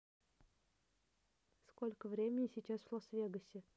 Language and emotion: Russian, neutral